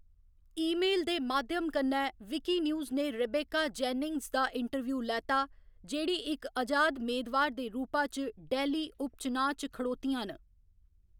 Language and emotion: Dogri, neutral